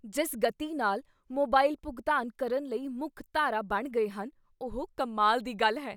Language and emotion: Punjabi, surprised